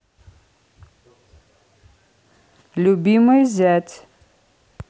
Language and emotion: Russian, neutral